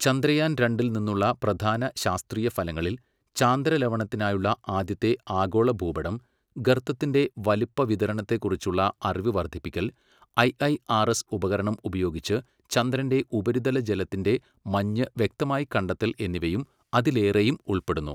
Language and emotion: Malayalam, neutral